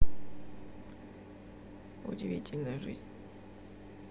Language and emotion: Russian, neutral